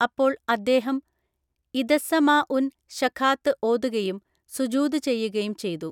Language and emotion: Malayalam, neutral